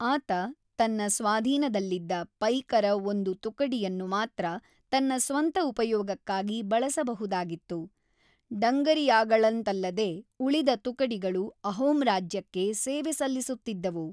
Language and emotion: Kannada, neutral